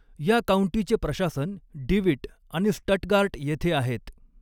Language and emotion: Marathi, neutral